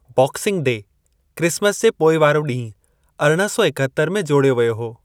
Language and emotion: Sindhi, neutral